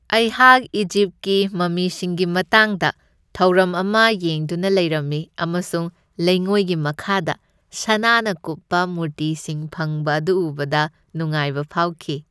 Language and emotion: Manipuri, happy